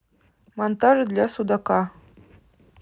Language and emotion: Russian, neutral